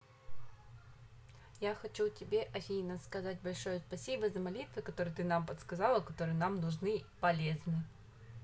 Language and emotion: Russian, positive